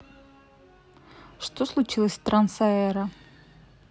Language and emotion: Russian, neutral